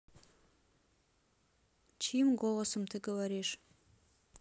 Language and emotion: Russian, neutral